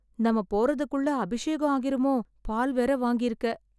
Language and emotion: Tamil, sad